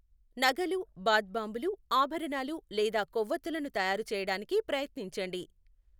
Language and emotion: Telugu, neutral